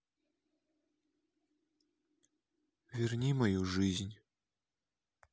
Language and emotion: Russian, sad